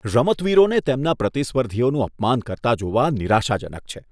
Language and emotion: Gujarati, disgusted